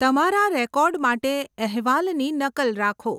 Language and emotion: Gujarati, neutral